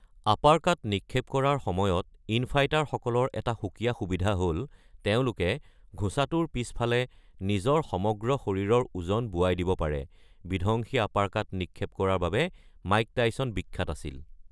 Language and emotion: Assamese, neutral